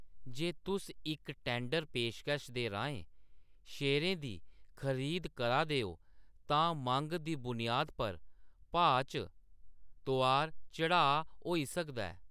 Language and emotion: Dogri, neutral